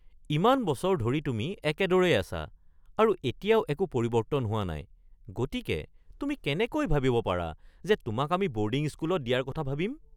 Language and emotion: Assamese, surprised